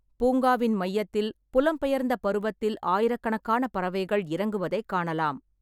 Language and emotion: Tamil, neutral